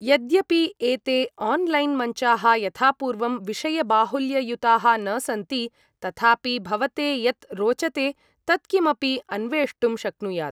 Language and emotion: Sanskrit, neutral